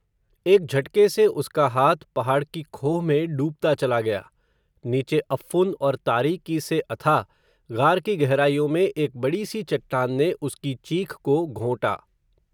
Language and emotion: Hindi, neutral